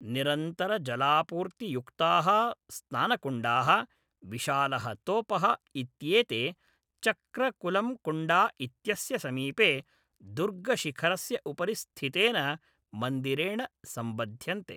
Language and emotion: Sanskrit, neutral